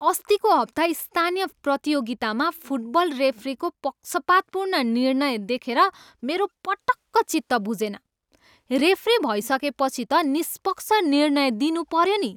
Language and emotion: Nepali, angry